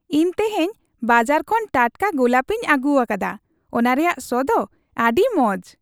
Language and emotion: Santali, happy